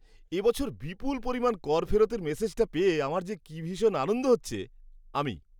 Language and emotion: Bengali, happy